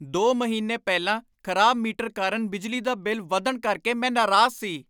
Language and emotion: Punjabi, angry